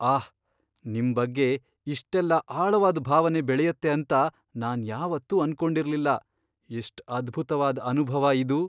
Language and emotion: Kannada, surprised